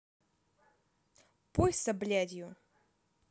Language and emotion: Russian, angry